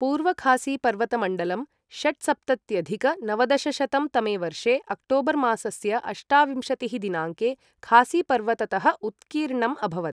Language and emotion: Sanskrit, neutral